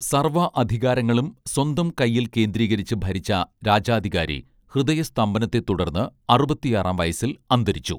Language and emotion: Malayalam, neutral